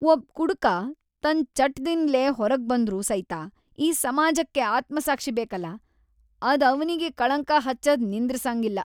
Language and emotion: Kannada, disgusted